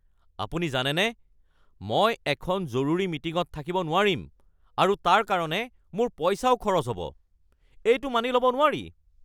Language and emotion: Assamese, angry